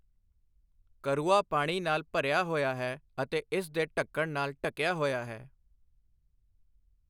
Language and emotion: Punjabi, neutral